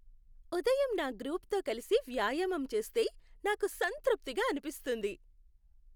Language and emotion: Telugu, happy